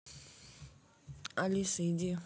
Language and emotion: Russian, neutral